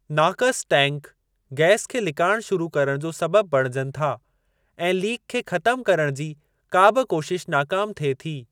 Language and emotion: Sindhi, neutral